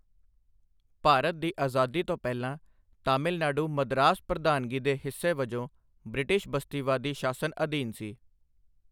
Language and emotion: Punjabi, neutral